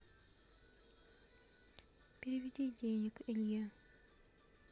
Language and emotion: Russian, neutral